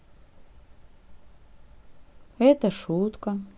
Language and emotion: Russian, sad